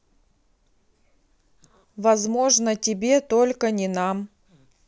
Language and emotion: Russian, neutral